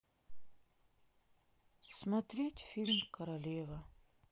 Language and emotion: Russian, sad